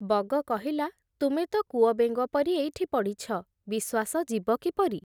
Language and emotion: Odia, neutral